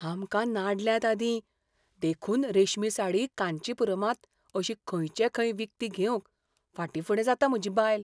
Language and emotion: Goan Konkani, fearful